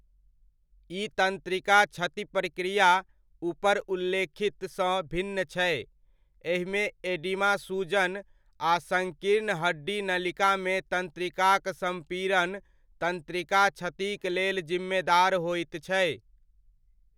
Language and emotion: Maithili, neutral